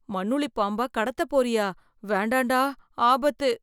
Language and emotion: Tamil, fearful